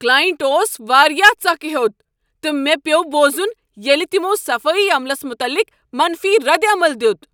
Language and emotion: Kashmiri, angry